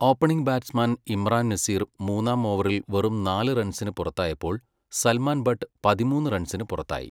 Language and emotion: Malayalam, neutral